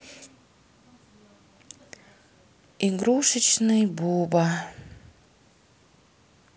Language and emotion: Russian, sad